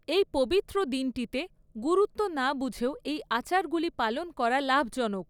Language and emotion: Bengali, neutral